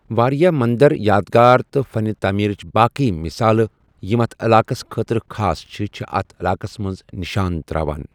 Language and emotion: Kashmiri, neutral